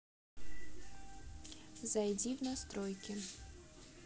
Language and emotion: Russian, neutral